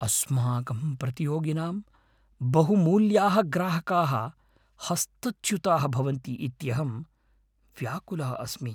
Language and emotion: Sanskrit, fearful